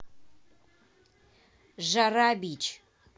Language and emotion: Russian, angry